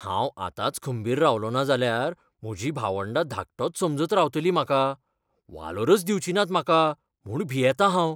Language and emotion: Goan Konkani, fearful